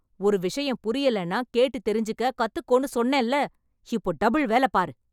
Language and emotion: Tamil, angry